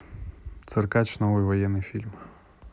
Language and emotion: Russian, neutral